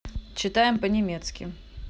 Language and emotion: Russian, neutral